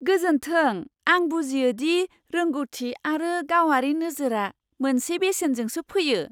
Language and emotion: Bodo, surprised